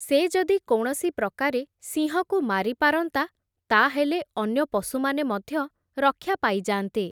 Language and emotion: Odia, neutral